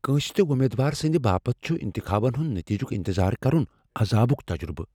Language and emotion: Kashmiri, fearful